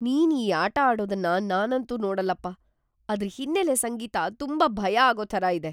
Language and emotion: Kannada, fearful